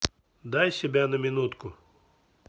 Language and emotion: Russian, neutral